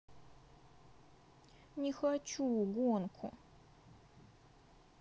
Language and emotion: Russian, sad